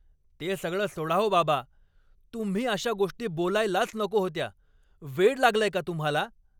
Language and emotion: Marathi, angry